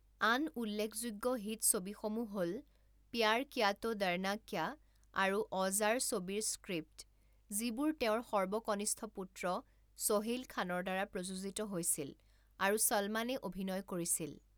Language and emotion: Assamese, neutral